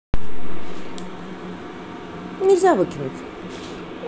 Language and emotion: Russian, neutral